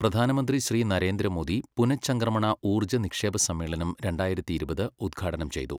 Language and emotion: Malayalam, neutral